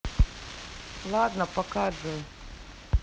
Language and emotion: Russian, neutral